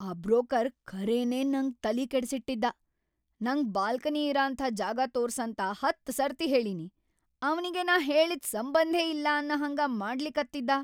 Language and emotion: Kannada, angry